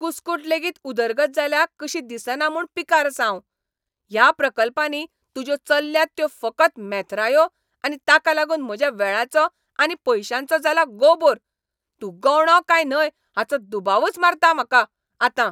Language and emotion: Goan Konkani, angry